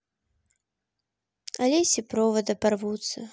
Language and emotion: Russian, sad